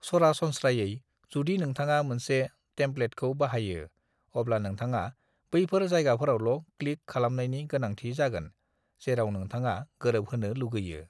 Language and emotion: Bodo, neutral